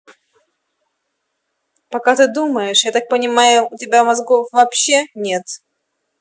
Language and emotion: Russian, angry